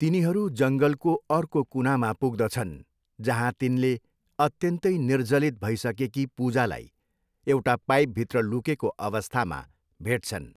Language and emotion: Nepali, neutral